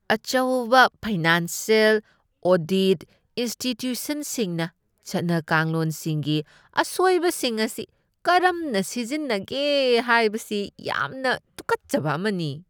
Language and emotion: Manipuri, disgusted